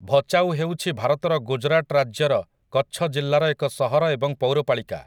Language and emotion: Odia, neutral